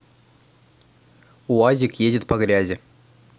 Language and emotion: Russian, neutral